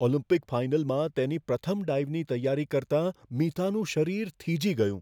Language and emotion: Gujarati, fearful